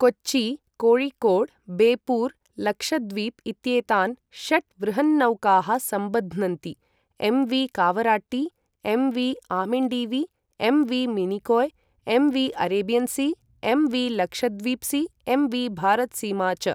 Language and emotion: Sanskrit, neutral